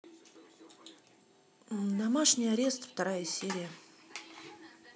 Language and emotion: Russian, neutral